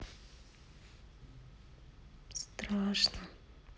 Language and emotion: Russian, neutral